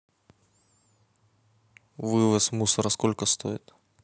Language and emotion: Russian, neutral